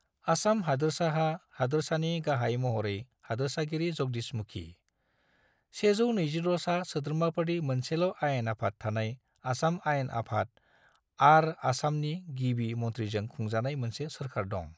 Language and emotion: Bodo, neutral